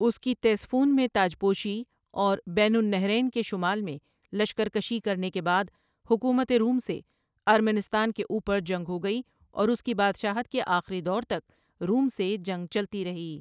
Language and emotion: Urdu, neutral